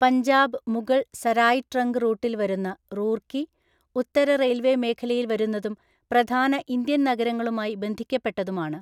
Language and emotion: Malayalam, neutral